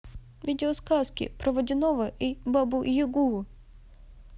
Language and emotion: Russian, neutral